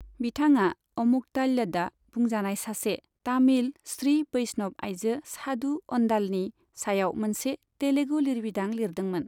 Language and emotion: Bodo, neutral